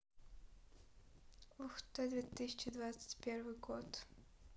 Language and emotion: Russian, neutral